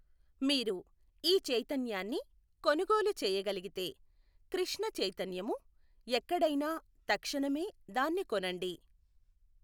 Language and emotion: Telugu, neutral